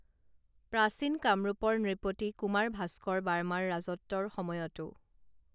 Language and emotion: Assamese, neutral